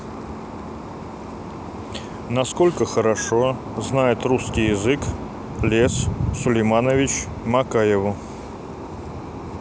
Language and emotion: Russian, neutral